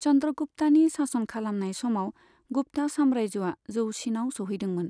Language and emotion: Bodo, neutral